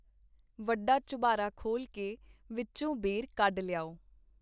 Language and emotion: Punjabi, neutral